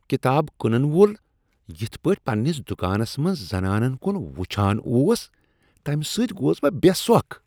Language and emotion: Kashmiri, disgusted